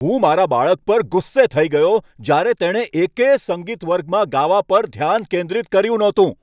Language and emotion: Gujarati, angry